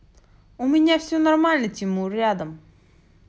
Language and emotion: Russian, neutral